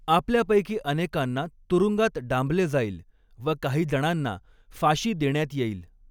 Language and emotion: Marathi, neutral